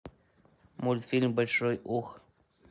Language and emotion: Russian, neutral